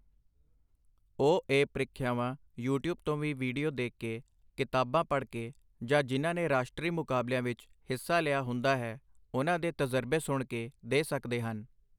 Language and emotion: Punjabi, neutral